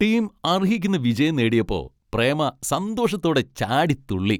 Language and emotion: Malayalam, happy